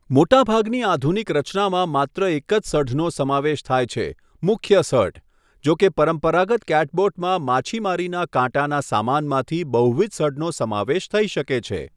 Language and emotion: Gujarati, neutral